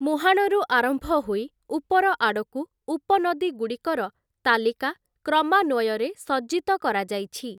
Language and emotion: Odia, neutral